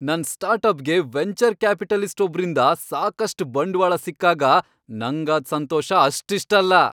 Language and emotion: Kannada, happy